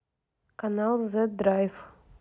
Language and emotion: Russian, neutral